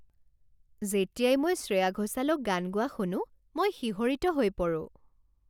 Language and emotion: Assamese, happy